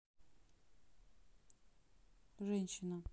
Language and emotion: Russian, neutral